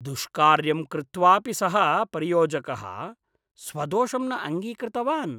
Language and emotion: Sanskrit, disgusted